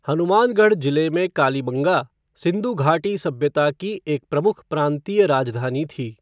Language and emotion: Hindi, neutral